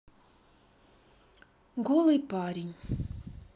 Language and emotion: Russian, neutral